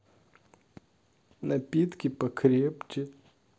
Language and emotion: Russian, sad